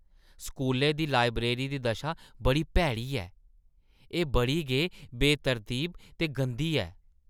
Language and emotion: Dogri, disgusted